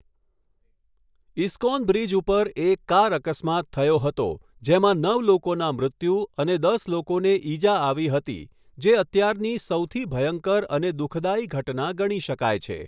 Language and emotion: Gujarati, neutral